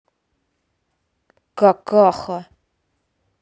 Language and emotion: Russian, angry